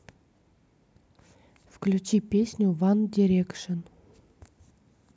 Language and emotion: Russian, neutral